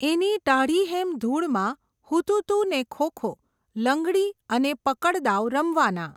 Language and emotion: Gujarati, neutral